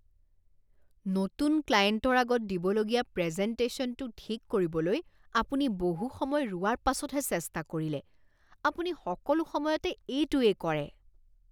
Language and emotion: Assamese, disgusted